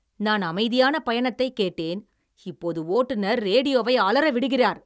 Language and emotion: Tamil, angry